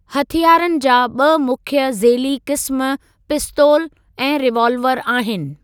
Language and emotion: Sindhi, neutral